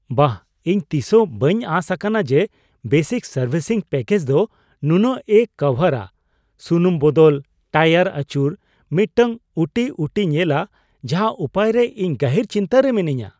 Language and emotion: Santali, surprised